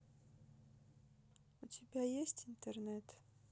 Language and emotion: Russian, neutral